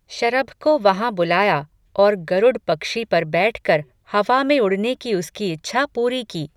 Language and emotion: Hindi, neutral